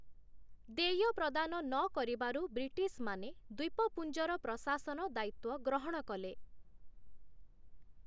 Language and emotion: Odia, neutral